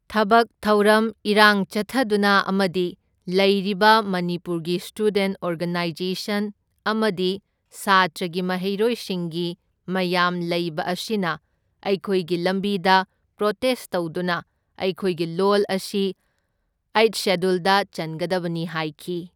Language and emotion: Manipuri, neutral